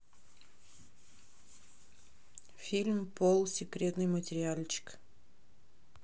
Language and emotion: Russian, neutral